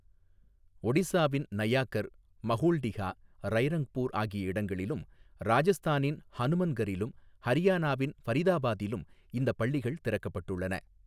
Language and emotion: Tamil, neutral